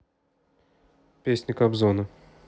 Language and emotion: Russian, neutral